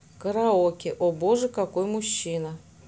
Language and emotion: Russian, neutral